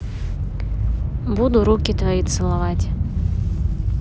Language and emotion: Russian, neutral